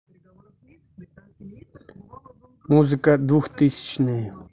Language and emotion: Russian, neutral